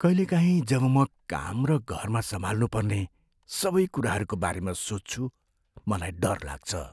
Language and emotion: Nepali, fearful